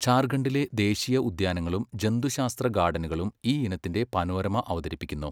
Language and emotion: Malayalam, neutral